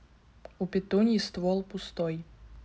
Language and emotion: Russian, neutral